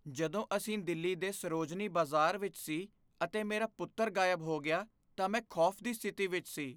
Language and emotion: Punjabi, fearful